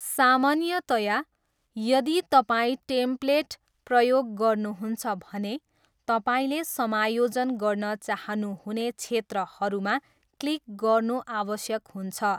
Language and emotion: Nepali, neutral